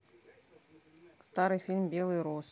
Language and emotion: Russian, neutral